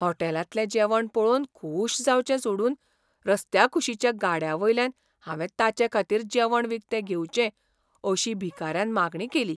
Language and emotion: Goan Konkani, surprised